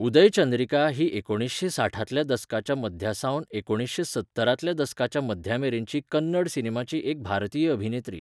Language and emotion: Goan Konkani, neutral